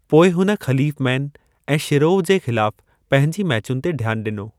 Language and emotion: Sindhi, neutral